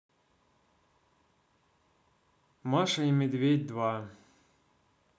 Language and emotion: Russian, neutral